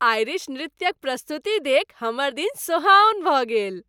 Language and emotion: Maithili, happy